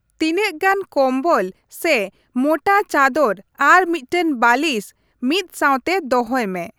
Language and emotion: Santali, neutral